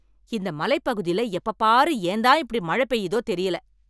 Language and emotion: Tamil, angry